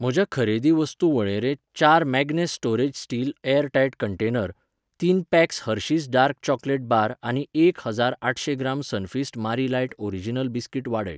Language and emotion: Goan Konkani, neutral